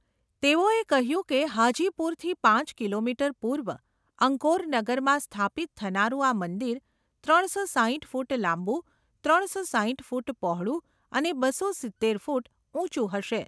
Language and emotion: Gujarati, neutral